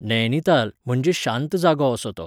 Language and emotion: Goan Konkani, neutral